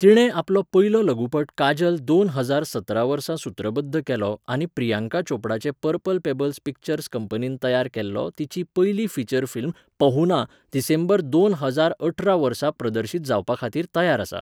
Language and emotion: Goan Konkani, neutral